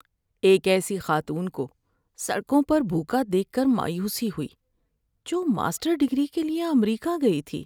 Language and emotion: Urdu, sad